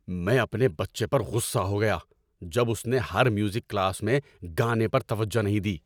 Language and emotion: Urdu, angry